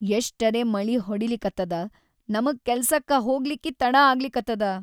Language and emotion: Kannada, sad